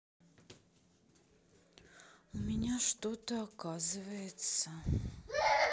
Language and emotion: Russian, sad